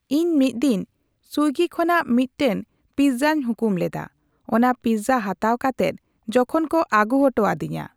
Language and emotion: Santali, neutral